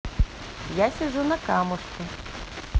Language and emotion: Russian, neutral